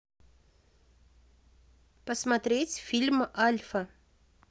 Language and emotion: Russian, neutral